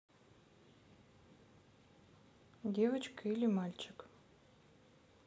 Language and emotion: Russian, neutral